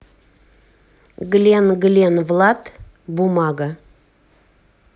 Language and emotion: Russian, neutral